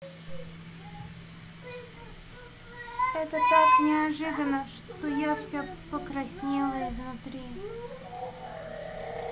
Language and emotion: Russian, neutral